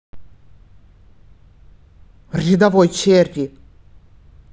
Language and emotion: Russian, angry